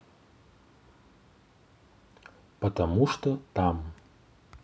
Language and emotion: Russian, neutral